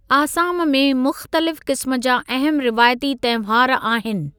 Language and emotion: Sindhi, neutral